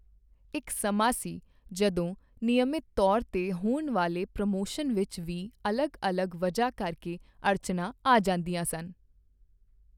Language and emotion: Punjabi, neutral